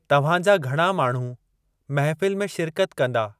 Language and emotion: Sindhi, neutral